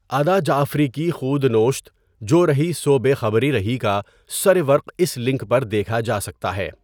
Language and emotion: Urdu, neutral